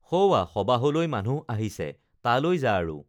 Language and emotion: Assamese, neutral